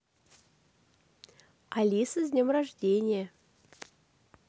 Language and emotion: Russian, positive